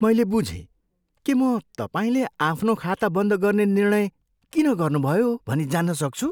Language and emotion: Nepali, surprised